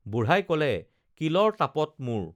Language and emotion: Assamese, neutral